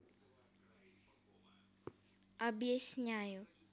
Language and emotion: Russian, neutral